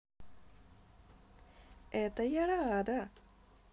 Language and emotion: Russian, positive